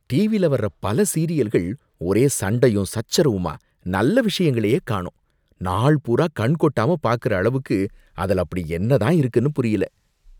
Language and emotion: Tamil, disgusted